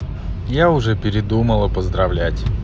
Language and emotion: Russian, neutral